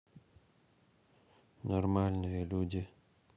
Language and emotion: Russian, neutral